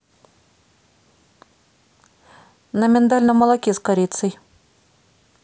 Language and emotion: Russian, neutral